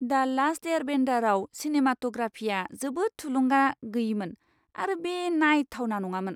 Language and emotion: Bodo, disgusted